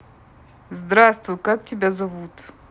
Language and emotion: Russian, neutral